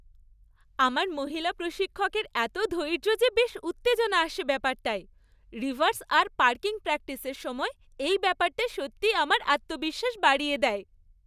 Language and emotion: Bengali, happy